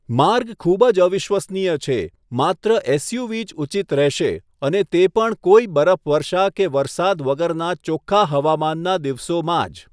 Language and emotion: Gujarati, neutral